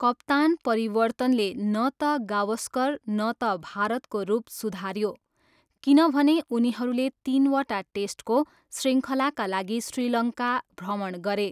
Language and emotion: Nepali, neutral